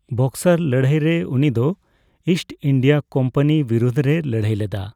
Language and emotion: Santali, neutral